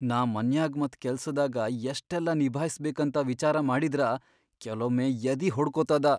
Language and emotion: Kannada, fearful